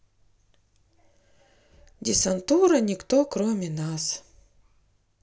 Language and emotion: Russian, sad